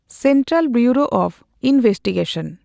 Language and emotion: Santali, neutral